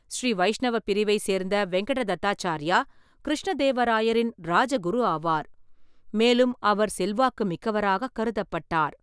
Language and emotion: Tamil, neutral